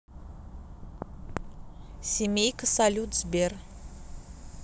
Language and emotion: Russian, neutral